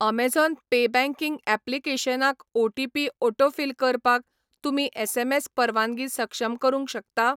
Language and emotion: Goan Konkani, neutral